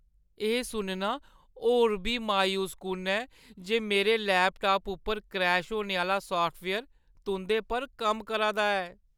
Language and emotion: Dogri, sad